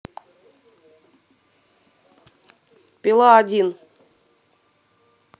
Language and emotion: Russian, neutral